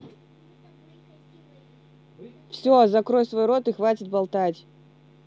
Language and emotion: Russian, angry